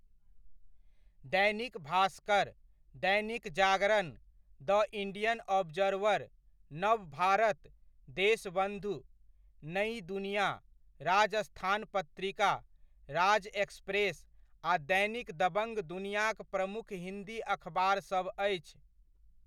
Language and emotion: Maithili, neutral